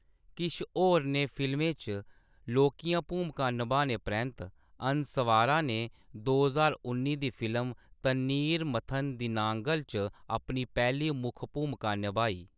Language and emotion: Dogri, neutral